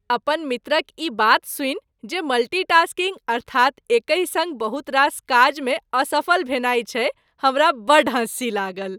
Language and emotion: Maithili, happy